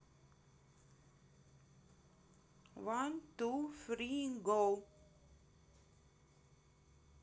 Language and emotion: Russian, neutral